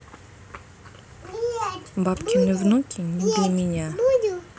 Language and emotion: Russian, neutral